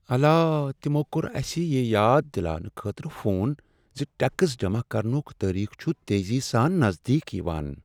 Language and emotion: Kashmiri, sad